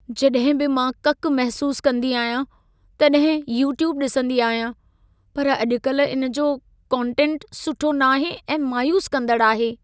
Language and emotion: Sindhi, sad